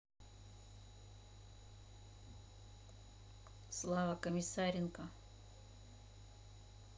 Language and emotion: Russian, neutral